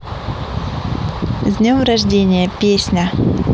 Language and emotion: Russian, positive